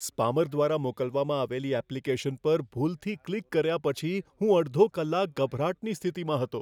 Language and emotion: Gujarati, fearful